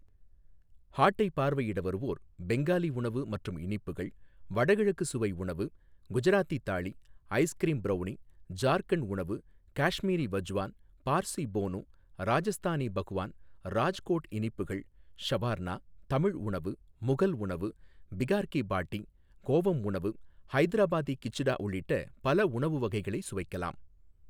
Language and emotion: Tamil, neutral